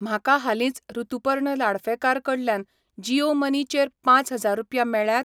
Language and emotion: Goan Konkani, neutral